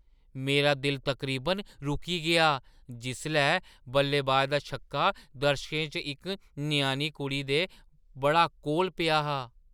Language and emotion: Dogri, surprised